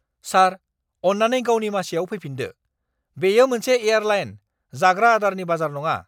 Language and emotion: Bodo, angry